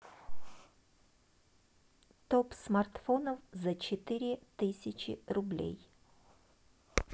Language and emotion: Russian, neutral